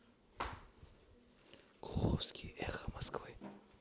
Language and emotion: Russian, neutral